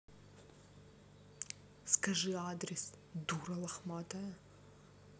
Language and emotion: Russian, angry